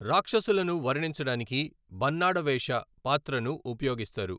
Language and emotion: Telugu, neutral